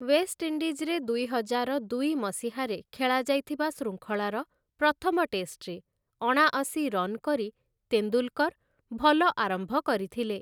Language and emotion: Odia, neutral